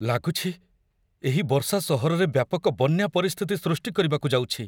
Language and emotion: Odia, fearful